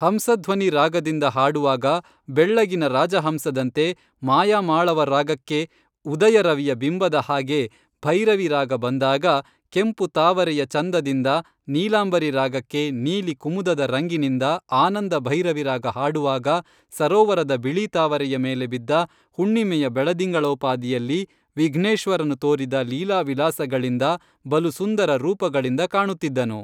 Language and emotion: Kannada, neutral